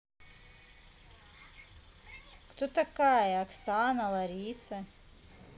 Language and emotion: Russian, neutral